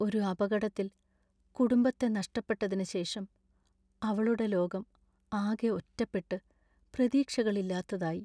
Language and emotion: Malayalam, sad